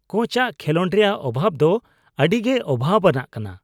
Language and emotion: Santali, disgusted